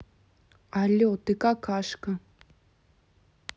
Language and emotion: Russian, neutral